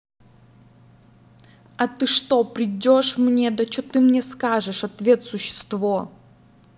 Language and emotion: Russian, angry